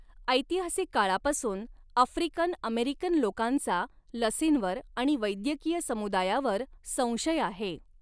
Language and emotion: Marathi, neutral